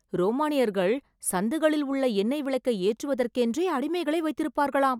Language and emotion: Tamil, surprised